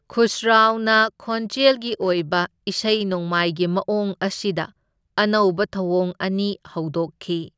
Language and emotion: Manipuri, neutral